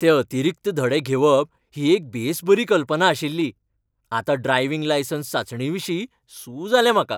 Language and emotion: Goan Konkani, happy